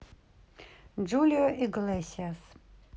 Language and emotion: Russian, neutral